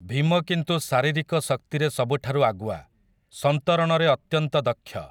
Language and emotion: Odia, neutral